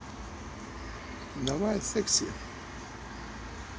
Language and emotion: Russian, neutral